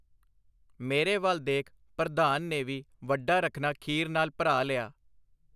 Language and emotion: Punjabi, neutral